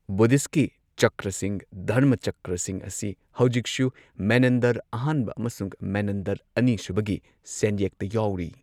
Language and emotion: Manipuri, neutral